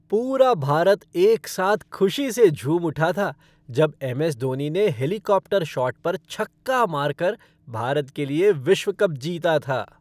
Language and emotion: Hindi, happy